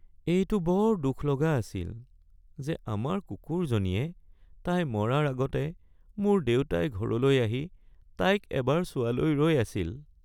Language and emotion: Assamese, sad